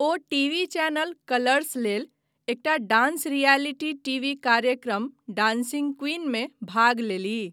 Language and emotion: Maithili, neutral